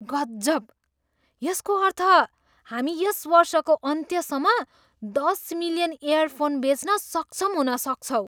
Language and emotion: Nepali, surprised